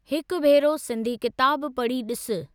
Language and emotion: Sindhi, neutral